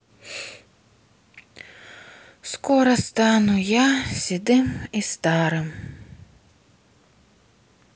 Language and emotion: Russian, sad